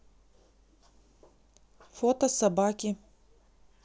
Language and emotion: Russian, neutral